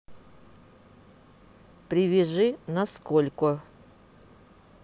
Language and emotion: Russian, neutral